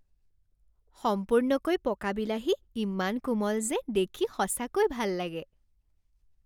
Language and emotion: Assamese, happy